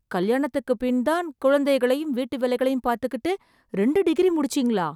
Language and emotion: Tamil, surprised